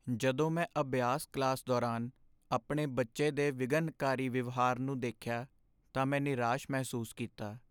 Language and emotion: Punjabi, sad